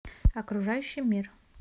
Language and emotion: Russian, neutral